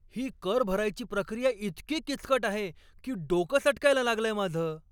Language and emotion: Marathi, angry